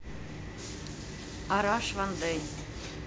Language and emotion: Russian, neutral